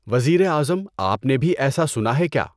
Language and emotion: Urdu, neutral